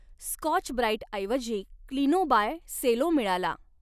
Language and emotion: Marathi, neutral